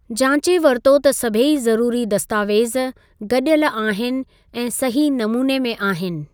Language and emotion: Sindhi, neutral